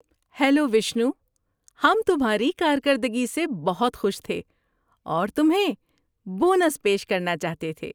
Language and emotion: Urdu, happy